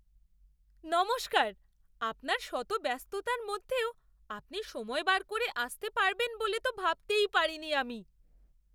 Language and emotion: Bengali, surprised